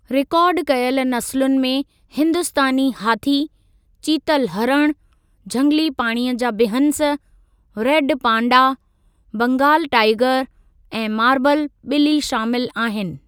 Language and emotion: Sindhi, neutral